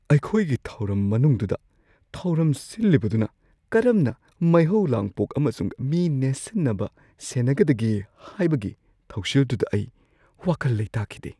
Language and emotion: Manipuri, fearful